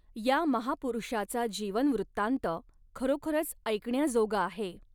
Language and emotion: Marathi, neutral